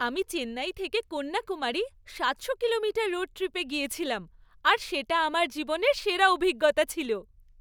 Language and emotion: Bengali, happy